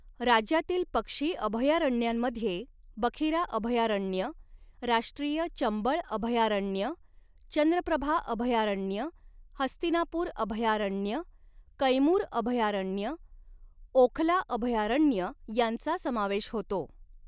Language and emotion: Marathi, neutral